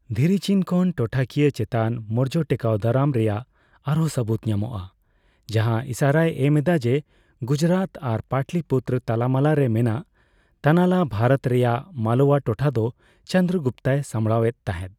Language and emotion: Santali, neutral